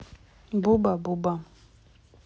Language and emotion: Russian, neutral